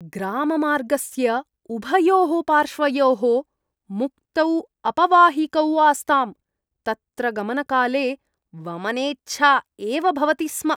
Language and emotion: Sanskrit, disgusted